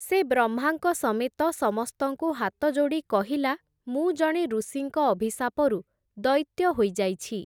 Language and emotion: Odia, neutral